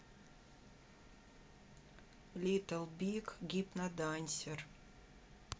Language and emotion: Russian, neutral